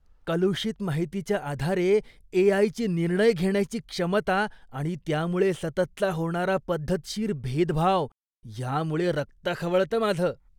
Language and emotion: Marathi, disgusted